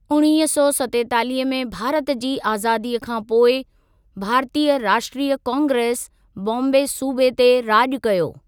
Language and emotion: Sindhi, neutral